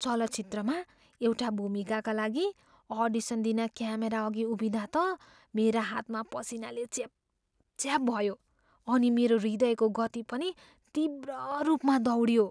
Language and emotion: Nepali, fearful